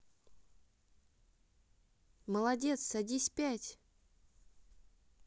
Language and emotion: Russian, positive